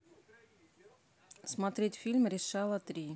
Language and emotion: Russian, neutral